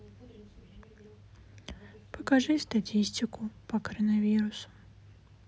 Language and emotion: Russian, sad